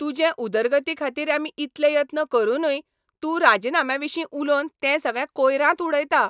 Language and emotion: Goan Konkani, angry